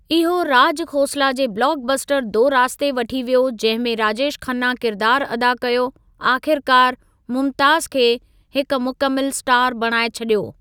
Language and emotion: Sindhi, neutral